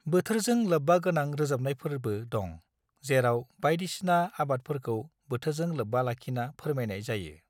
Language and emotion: Bodo, neutral